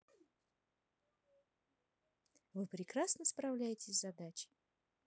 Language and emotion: Russian, positive